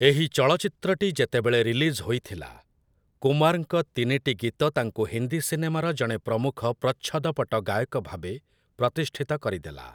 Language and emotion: Odia, neutral